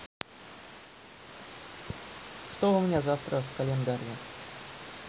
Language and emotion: Russian, neutral